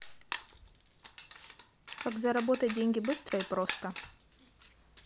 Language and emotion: Russian, neutral